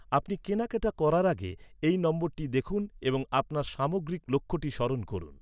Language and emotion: Bengali, neutral